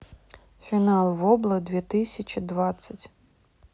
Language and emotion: Russian, neutral